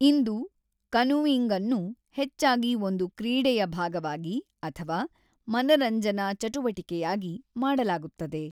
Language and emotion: Kannada, neutral